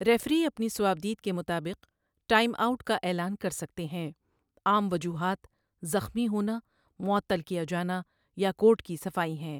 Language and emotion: Urdu, neutral